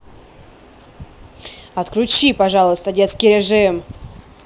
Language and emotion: Russian, angry